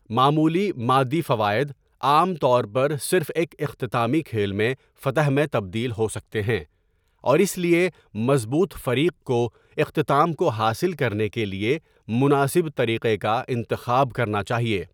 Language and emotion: Urdu, neutral